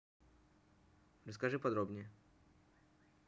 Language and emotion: Russian, neutral